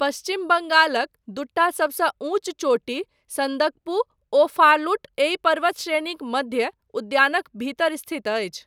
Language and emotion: Maithili, neutral